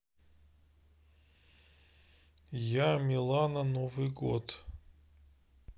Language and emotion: Russian, neutral